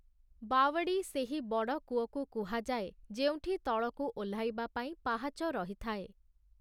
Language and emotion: Odia, neutral